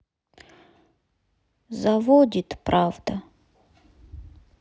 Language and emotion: Russian, sad